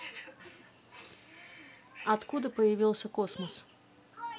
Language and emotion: Russian, neutral